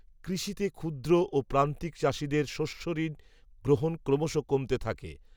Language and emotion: Bengali, neutral